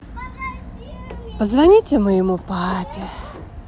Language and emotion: Russian, positive